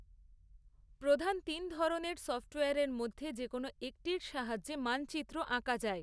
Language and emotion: Bengali, neutral